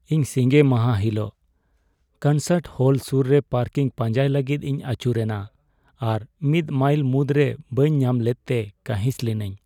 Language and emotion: Santali, sad